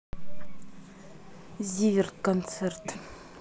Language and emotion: Russian, neutral